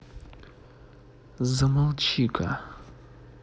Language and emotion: Russian, angry